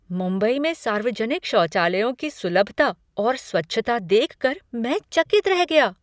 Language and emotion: Hindi, surprised